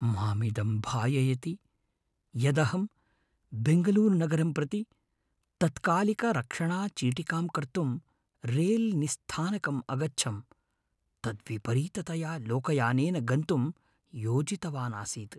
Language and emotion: Sanskrit, fearful